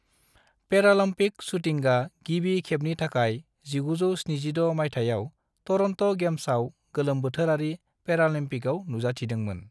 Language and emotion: Bodo, neutral